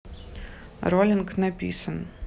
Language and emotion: Russian, neutral